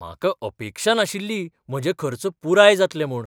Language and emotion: Goan Konkani, surprised